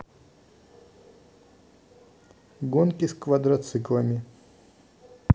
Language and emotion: Russian, neutral